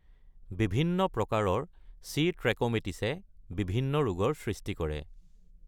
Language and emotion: Assamese, neutral